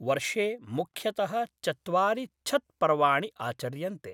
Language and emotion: Sanskrit, neutral